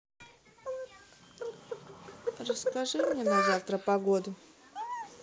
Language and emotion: Russian, neutral